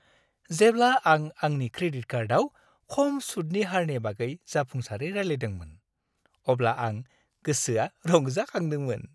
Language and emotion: Bodo, happy